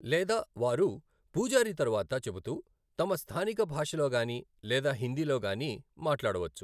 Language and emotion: Telugu, neutral